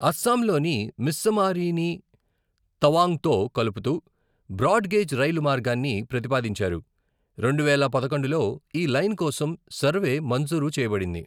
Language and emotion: Telugu, neutral